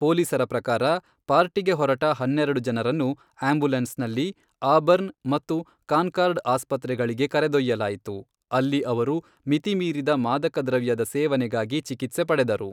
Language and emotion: Kannada, neutral